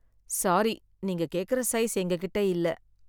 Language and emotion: Tamil, sad